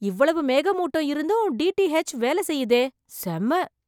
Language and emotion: Tamil, surprised